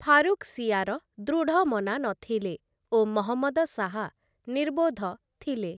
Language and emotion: Odia, neutral